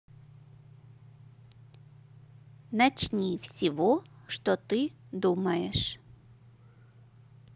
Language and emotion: Russian, neutral